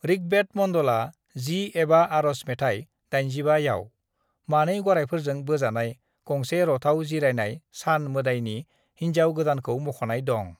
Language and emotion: Bodo, neutral